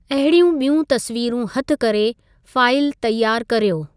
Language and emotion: Sindhi, neutral